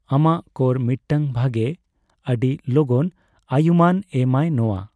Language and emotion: Santali, neutral